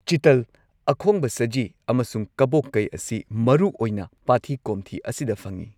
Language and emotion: Manipuri, neutral